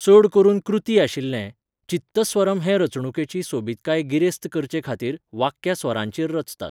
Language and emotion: Goan Konkani, neutral